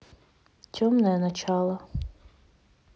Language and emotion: Russian, neutral